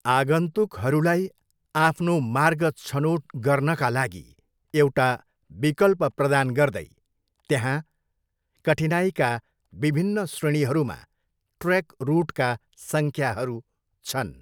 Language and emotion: Nepali, neutral